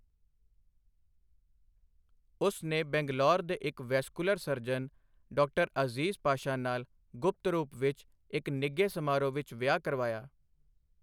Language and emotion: Punjabi, neutral